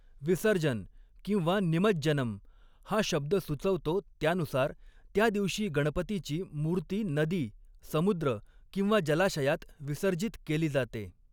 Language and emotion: Marathi, neutral